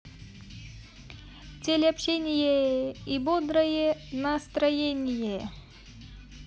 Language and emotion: Russian, positive